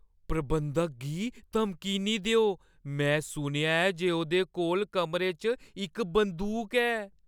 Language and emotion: Dogri, fearful